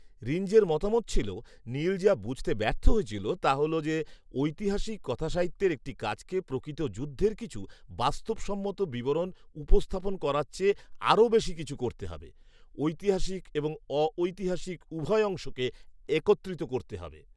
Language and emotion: Bengali, neutral